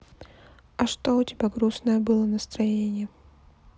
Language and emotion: Russian, sad